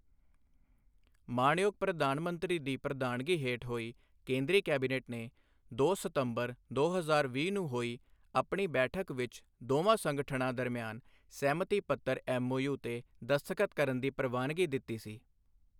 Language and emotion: Punjabi, neutral